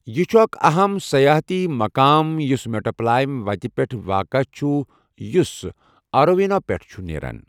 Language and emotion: Kashmiri, neutral